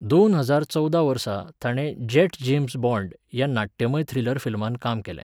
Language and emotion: Goan Konkani, neutral